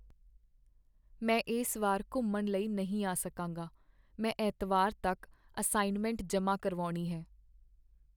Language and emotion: Punjabi, sad